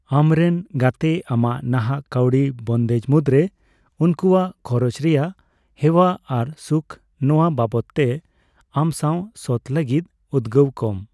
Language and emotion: Santali, neutral